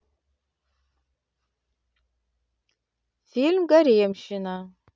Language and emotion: Russian, neutral